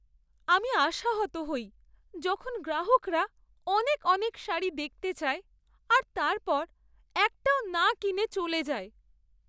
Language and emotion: Bengali, sad